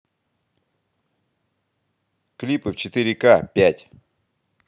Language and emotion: Russian, positive